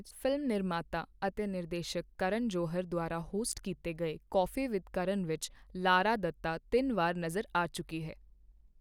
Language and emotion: Punjabi, neutral